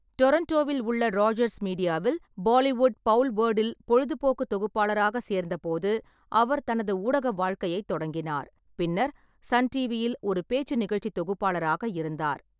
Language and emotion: Tamil, neutral